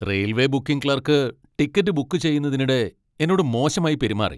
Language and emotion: Malayalam, angry